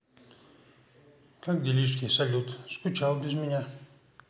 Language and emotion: Russian, neutral